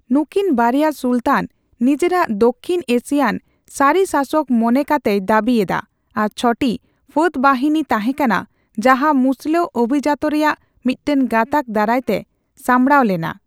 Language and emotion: Santali, neutral